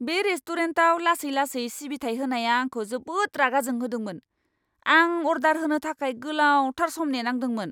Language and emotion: Bodo, angry